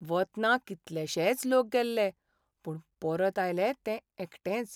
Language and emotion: Goan Konkani, sad